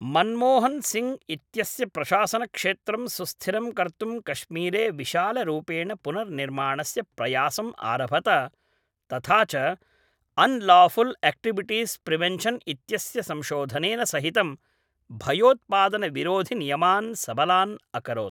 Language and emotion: Sanskrit, neutral